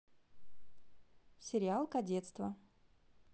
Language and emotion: Russian, positive